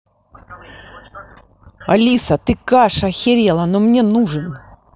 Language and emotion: Russian, angry